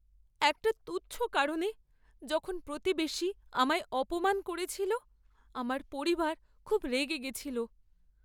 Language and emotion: Bengali, sad